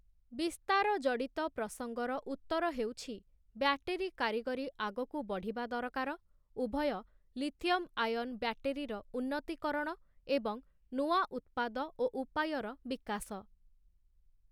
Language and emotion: Odia, neutral